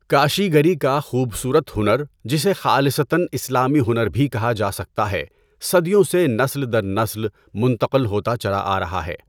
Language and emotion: Urdu, neutral